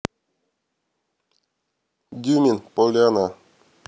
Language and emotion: Russian, neutral